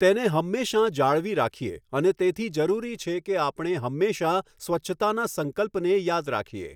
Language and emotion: Gujarati, neutral